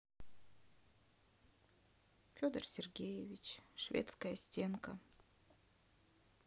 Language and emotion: Russian, sad